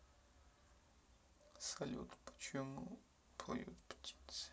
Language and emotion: Russian, sad